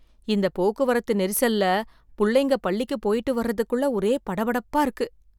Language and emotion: Tamil, fearful